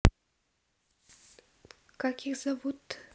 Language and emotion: Russian, neutral